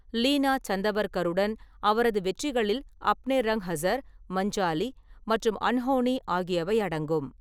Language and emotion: Tamil, neutral